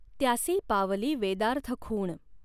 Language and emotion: Marathi, neutral